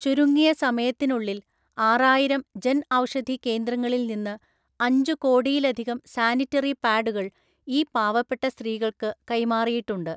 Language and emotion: Malayalam, neutral